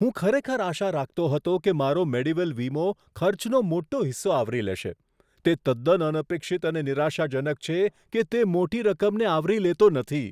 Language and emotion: Gujarati, surprised